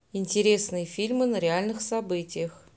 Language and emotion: Russian, neutral